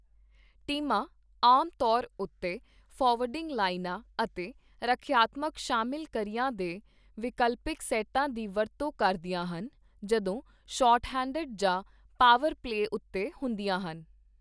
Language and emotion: Punjabi, neutral